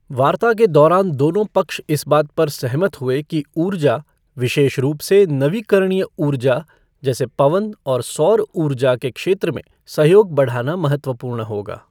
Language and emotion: Hindi, neutral